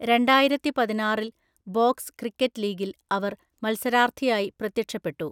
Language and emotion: Malayalam, neutral